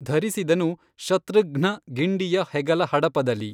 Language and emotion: Kannada, neutral